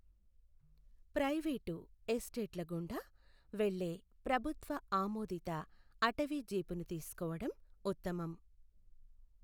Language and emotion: Telugu, neutral